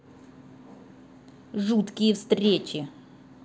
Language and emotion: Russian, angry